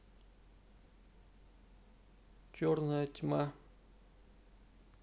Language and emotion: Russian, neutral